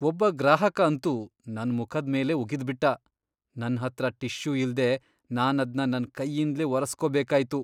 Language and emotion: Kannada, disgusted